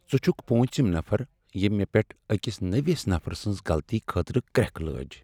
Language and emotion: Kashmiri, sad